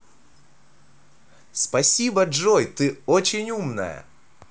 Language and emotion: Russian, positive